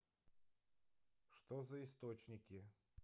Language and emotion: Russian, neutral